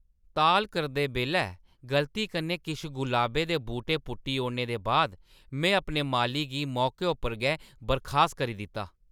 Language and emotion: Dogri, angry